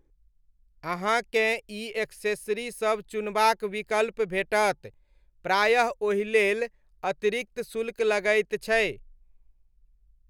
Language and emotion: Maithili, neutral